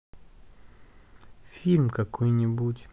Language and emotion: Russian, sad